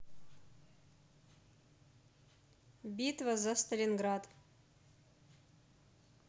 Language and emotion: Russian, neutral